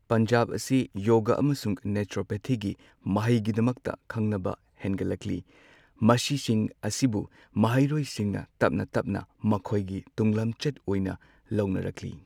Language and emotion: Manipuri, neutral